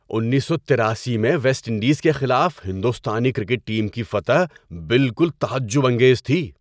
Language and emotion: Urdu, surprised